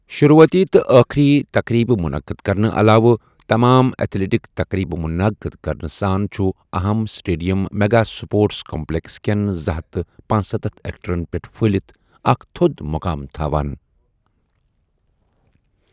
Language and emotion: Kashmiri, neutral